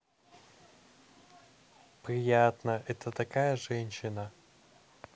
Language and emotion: Russian, positive